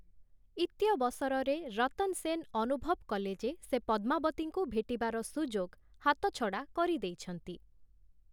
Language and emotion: Odia, neutral